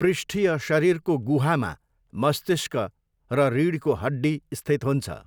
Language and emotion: Nepali, neutral